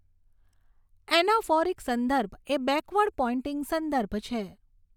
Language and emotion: Gujarati, neutral